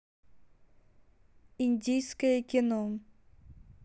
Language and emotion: Russian, neutral